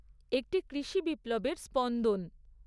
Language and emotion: Bengali, neutral